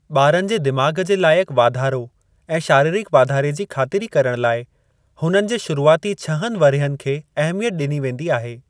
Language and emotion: Sindhi, neutral